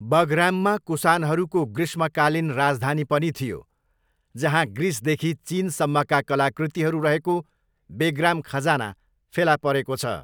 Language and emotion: Nepali, neutral